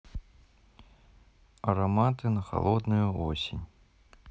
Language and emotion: Russian, neutral